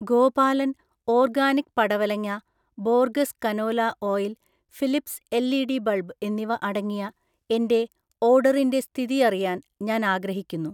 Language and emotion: Malayalam, neutral